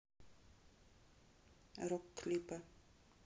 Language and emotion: Russian, neutral